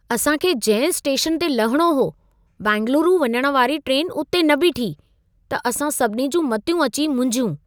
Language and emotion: Sindhi, surprised